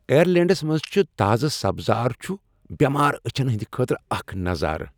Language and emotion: Kashmiri, happy